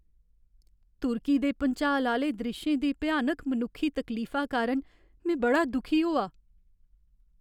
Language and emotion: Dogri, sad